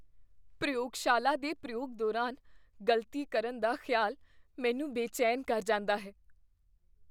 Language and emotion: Punjabi, fearful